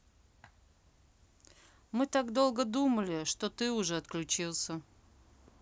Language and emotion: Russian, neutral